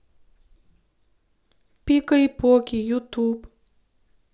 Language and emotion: Russian, neutral